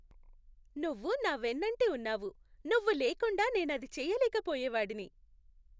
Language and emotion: Telugu, happy